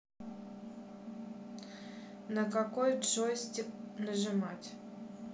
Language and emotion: Russian, neutral